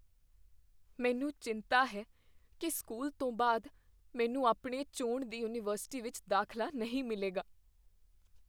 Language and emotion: Punjabi, fearful